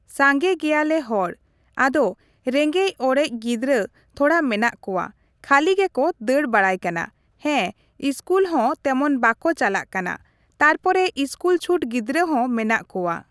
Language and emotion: Santali, neutral